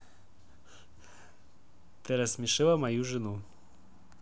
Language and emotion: Russian, neutral